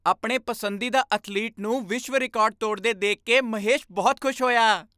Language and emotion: Punjabi, happy